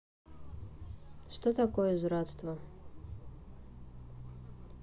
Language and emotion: Russian, neutral